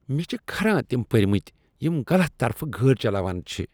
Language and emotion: Kashmiri, disgusted